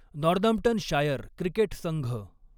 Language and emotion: Marathi, neutral